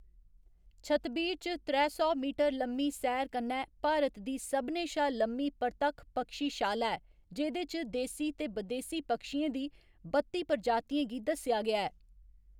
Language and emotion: Dogri, neutral